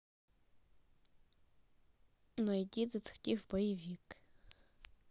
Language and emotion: Russian, neutral